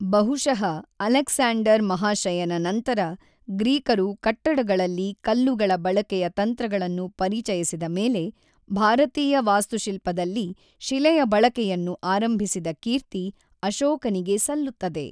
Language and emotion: Kannada, neutral